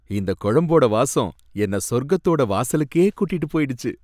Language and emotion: Tamil, happy